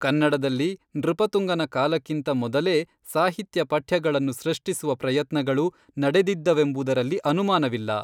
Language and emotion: Kannada, neutral